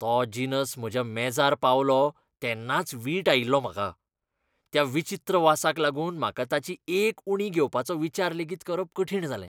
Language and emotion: Goan Konkani, disgusted